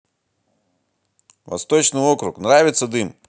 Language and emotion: Russian, positive